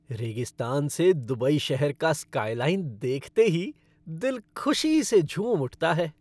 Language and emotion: Hindi, happy